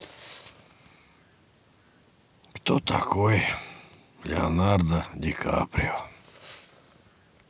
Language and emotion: Russian, sad